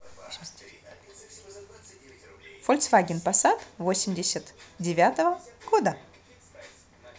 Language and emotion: Russian, positive